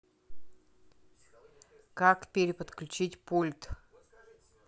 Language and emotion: Russian, neutral